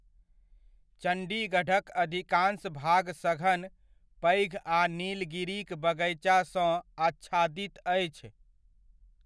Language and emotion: Maithili, neutral